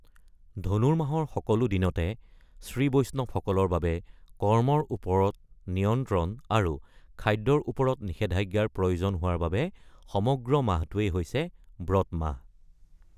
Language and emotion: Assamese, neutral